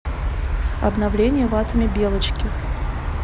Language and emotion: Russian, neutral